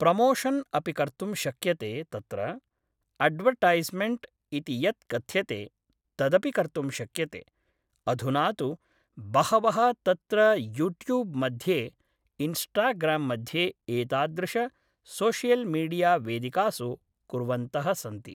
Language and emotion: Sanskrit, neutral